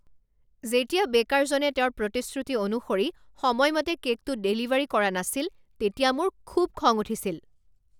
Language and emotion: Assamese, angry